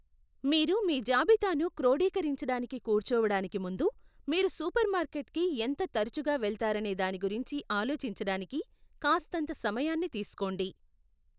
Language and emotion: Telugu, neutral